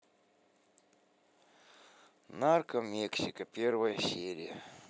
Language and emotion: Russian, sad